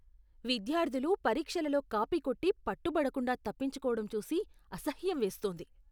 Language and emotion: Telugu, disgusted